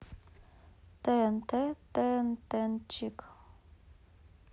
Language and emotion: Russian, neutral